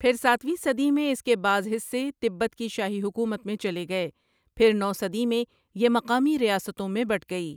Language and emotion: Urdu, neutral